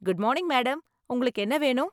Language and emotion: Tamil, happy